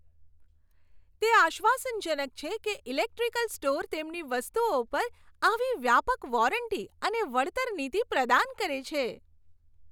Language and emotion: Gujarati, happy